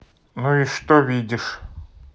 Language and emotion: Russian, neutral